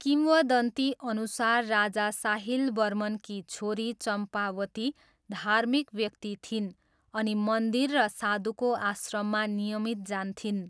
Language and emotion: Nepali, neutral